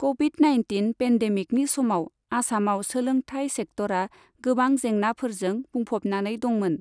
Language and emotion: Bodo, neutral